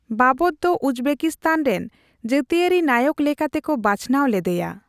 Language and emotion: Santali, neutral